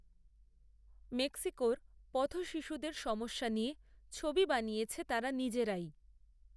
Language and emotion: Bengali, neutral